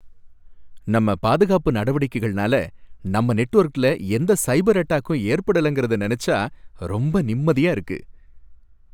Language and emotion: Tamil, happy